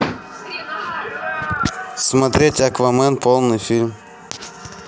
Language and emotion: Russian, neutral